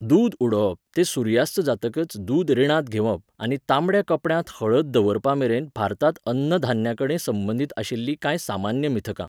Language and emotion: Goan Konkani, neutral